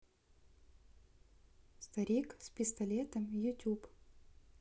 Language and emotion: Russian, neutral